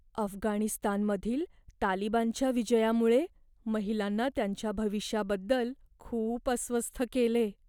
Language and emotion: Marathi, fearful